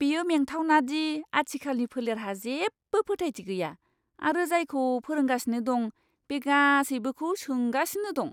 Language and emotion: Bodo, disgusted